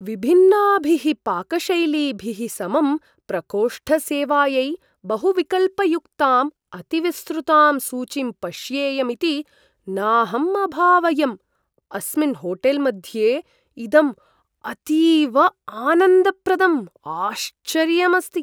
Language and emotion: Sanskrit, surprised